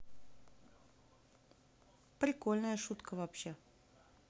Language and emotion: Russian, positive